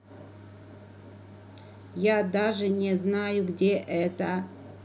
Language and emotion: Russian, neutral